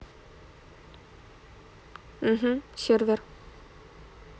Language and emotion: Russian, neutral